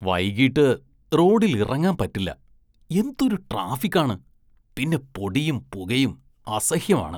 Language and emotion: Malayalam, disgusted